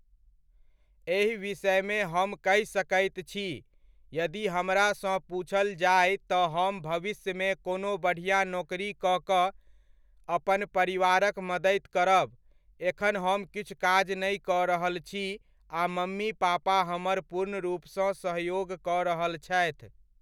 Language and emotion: Maithili, neutral